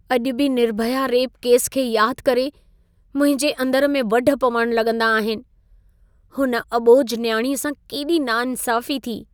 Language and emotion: Sindhi, sad